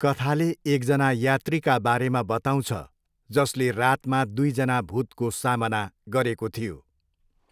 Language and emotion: Nepali, neutral